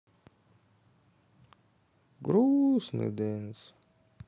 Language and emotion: Russian, sad